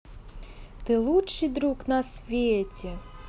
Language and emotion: Russian, positive